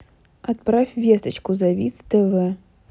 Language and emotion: Russian, neutral